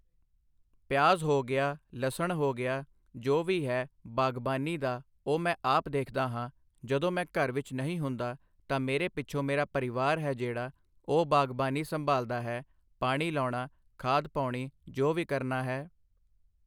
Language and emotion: Punjabi, neutral